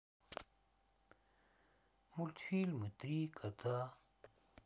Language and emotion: Russian, sad